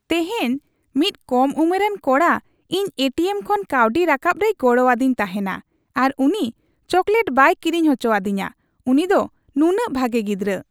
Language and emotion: Santali, happy